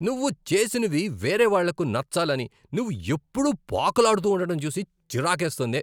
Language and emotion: Telugu, angry